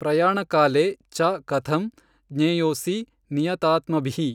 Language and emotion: Kannada, neutral